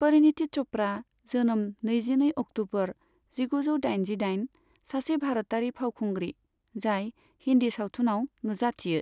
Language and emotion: Bodo, neutral